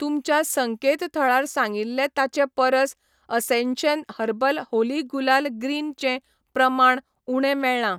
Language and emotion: Goan Konkani, neutral